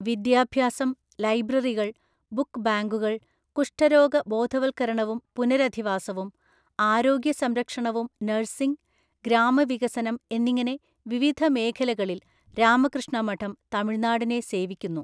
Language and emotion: Malayalam, neutral